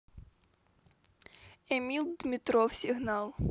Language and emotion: Russian, neutral